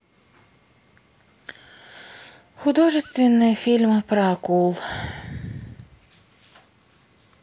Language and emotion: Russian, sad